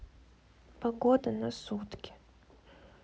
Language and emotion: Russian, sad